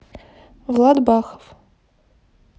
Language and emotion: Russian, neutral